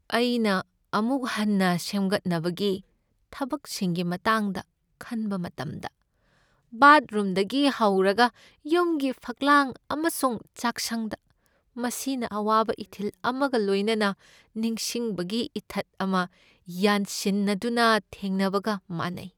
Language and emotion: Manipuri, sad